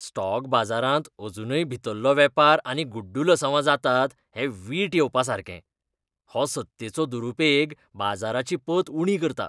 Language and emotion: Goan Konkani, disgusted